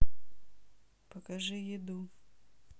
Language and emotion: Russian, neutral